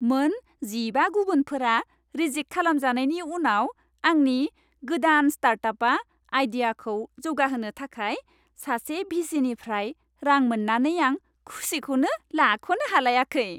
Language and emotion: Bodo, happy